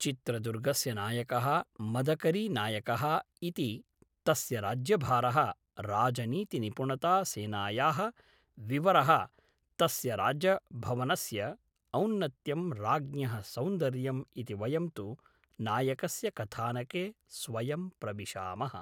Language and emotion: Sanskrit, neutral